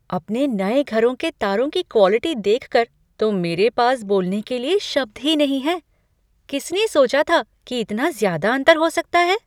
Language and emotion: Hindi, surprised